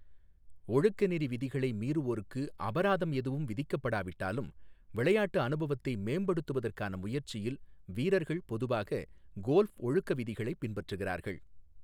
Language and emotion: Tamil, neutral